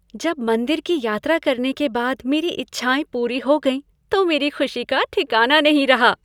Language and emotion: Hindi, happy